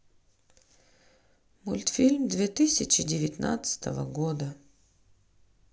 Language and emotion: Russian, sad